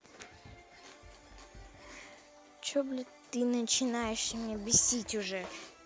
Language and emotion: Russian, angry